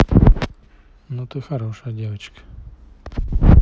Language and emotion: Russian, neutral